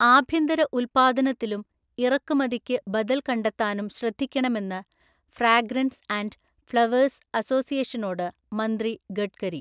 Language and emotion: Malayalam, neutral